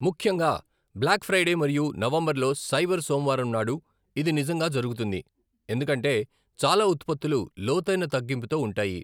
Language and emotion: Telugu, neutral